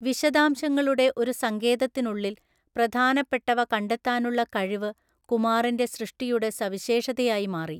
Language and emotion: Malayalam, neutral